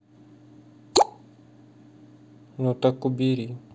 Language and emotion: Russian, sad